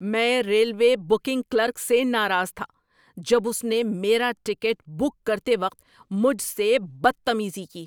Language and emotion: Urdu, angry